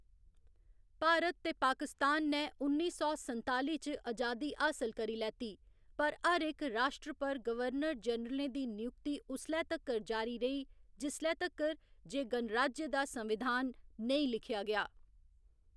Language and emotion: Dogri, neutral